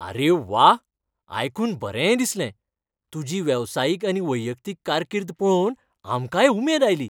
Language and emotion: Goan Konkani, happy